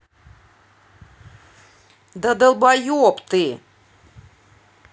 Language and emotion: Russian, angry